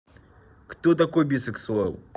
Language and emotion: Russian, neutral